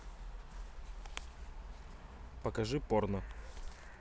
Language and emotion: Russian, neutral